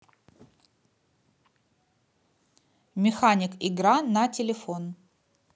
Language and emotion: Russian, neutral